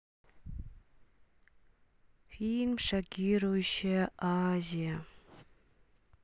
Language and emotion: Russian, sad